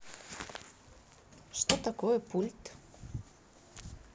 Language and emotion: Russian, neutral